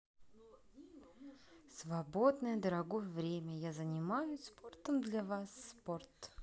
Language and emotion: Russian, positive